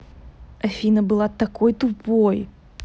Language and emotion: Russian, angry